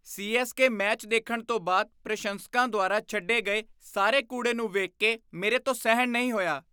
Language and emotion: Punjabi, disgusted